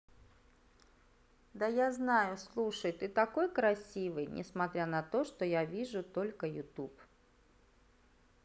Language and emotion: Russian, neutral